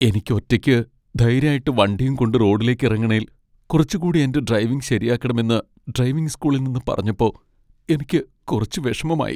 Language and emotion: Malayalam, sad